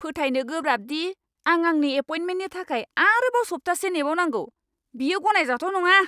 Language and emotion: Bodo, angry